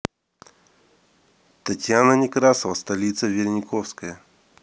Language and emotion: Russian, neutral